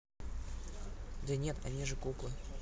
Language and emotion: Russian, neutral